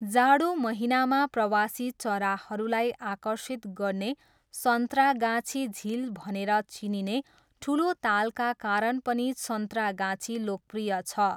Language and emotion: Nepali, neutral